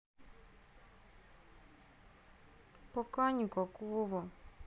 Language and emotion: Russian, sad